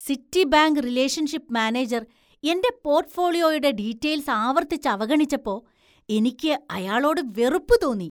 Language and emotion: Malayalam, disgusted